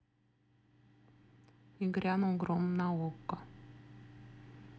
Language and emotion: Russian, neutral